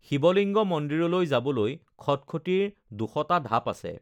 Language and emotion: Assamese, neutral